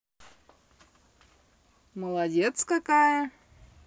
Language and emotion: Russian, positive